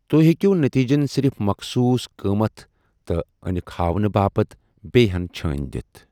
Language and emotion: Kashmiri, neutral